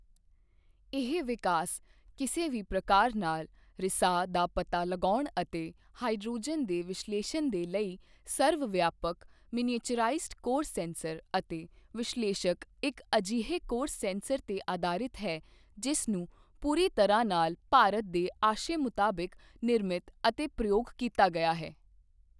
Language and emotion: Punjabi, neutral